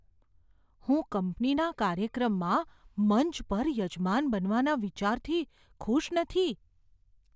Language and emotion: Gujarati, fearful